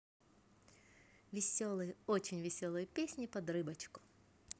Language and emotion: Russian, positive